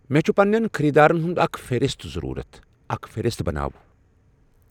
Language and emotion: Kashmiri, neutral